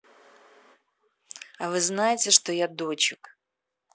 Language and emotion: Russian, angry